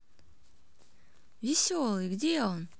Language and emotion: Russian, positive